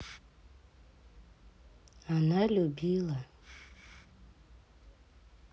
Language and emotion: Russian, sad